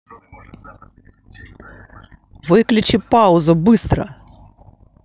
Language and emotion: Russian, angry